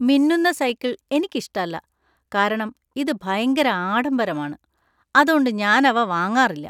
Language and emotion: Malayalam, disgusted